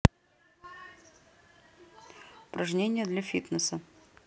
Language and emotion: Russian, neutral